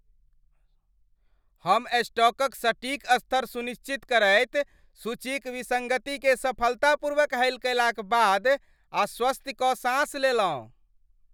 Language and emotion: Maithili, happy